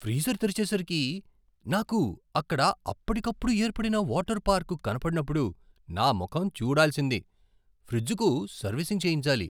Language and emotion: Telugu, surprised